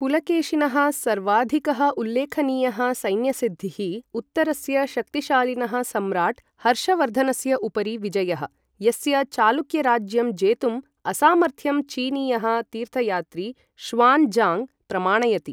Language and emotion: Sanskrit, neutral